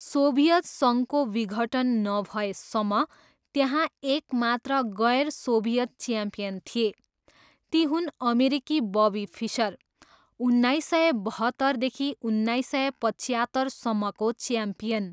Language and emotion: Nepali, neutral